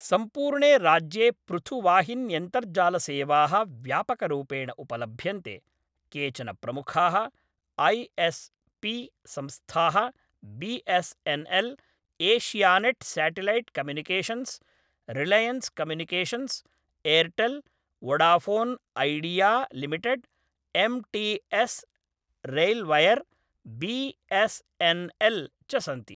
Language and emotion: Sanskrit, neutral